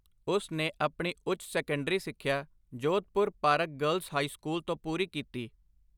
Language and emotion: Punjabi, neutral